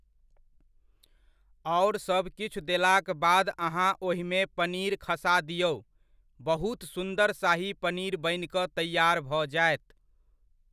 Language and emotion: Maithili, neutral